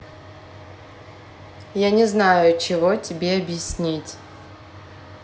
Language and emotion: Russian, neutral